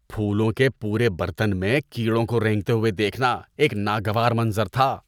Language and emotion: Urdu, disgusted